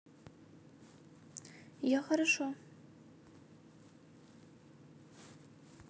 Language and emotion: Russian, neutral